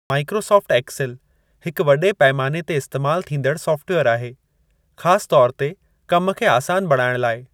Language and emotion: Sindhi, neutral